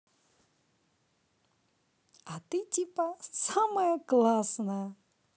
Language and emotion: Russian, neutral